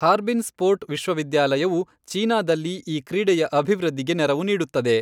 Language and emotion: Kannada, neutral